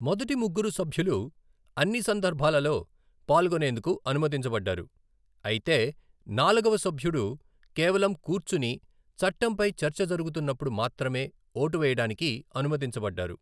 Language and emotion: Telugu, neutral